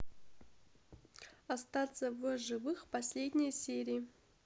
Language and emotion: Russian, neutral